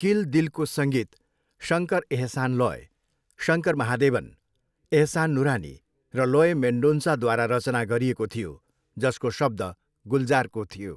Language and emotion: Nepali, neutral